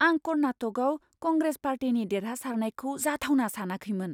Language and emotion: Bodo, surprised